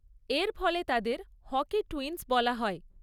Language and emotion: Bengali, neutral